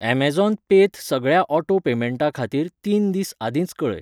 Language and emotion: Goan Konkani, neutral